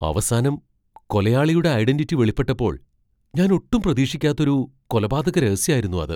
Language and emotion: Malayalam, surprised